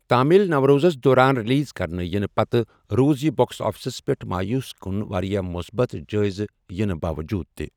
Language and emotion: Kashmiri, neutral